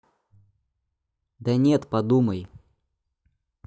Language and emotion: Russian, neutral